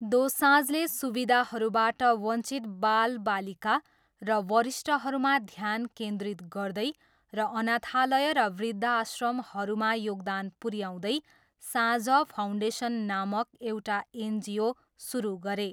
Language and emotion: Nepali, neutral